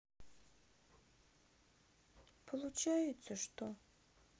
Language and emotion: Russian, sad